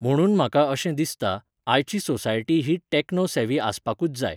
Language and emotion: Goan Konkani, neutral